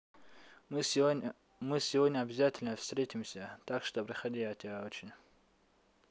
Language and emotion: Russian, neutral